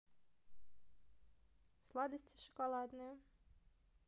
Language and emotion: Russian, neutral